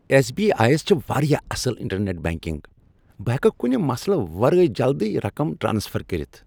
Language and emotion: Kashmiri, happy